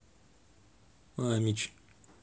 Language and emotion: Russian, neutral